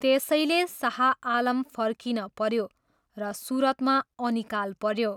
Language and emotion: Nepali, neutral